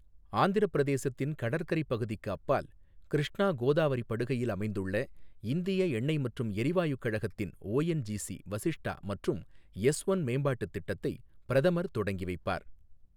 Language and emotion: Tamil, neutral